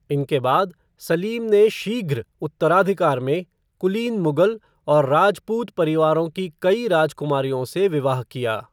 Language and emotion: Hindi, neutral